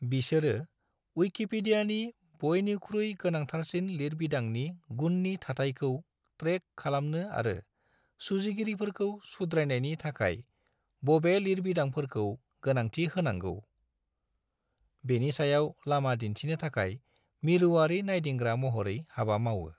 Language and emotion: Bodo, neutral